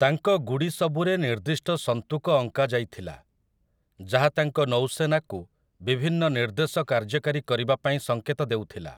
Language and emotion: Odia, neutral